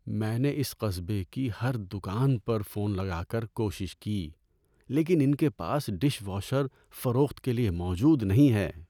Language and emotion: Urdu, sad